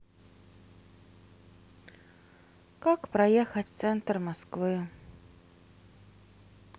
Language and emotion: Russian, sad